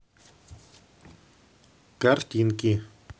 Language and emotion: Russian, neutral